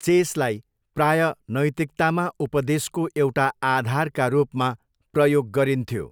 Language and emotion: Nepali, neutral